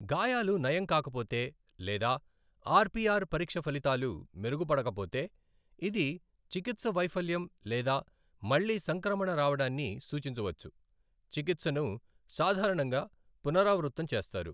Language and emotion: Telugu, neutral